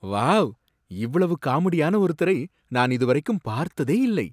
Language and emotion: Tamil, surprised